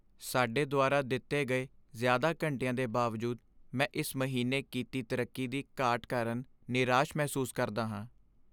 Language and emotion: Punjabi, sad